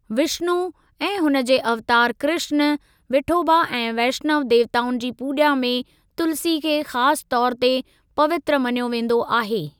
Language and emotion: Sindhi, neutral